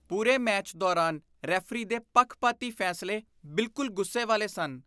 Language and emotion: Punjabi, disgusted